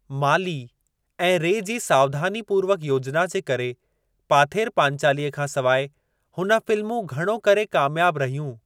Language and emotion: Sindhi, neutral